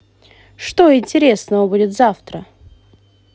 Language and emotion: Russian, positive